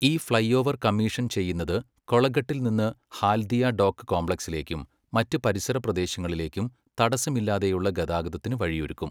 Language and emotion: Malayalam, neutral